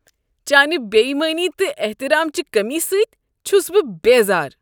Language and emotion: Kashmiri, disgusted